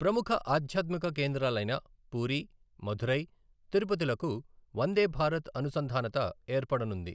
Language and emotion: Telugu, neutral